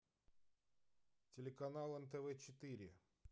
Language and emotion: Russian, neutral